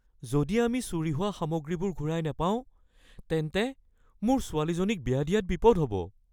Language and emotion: Assamese, fearful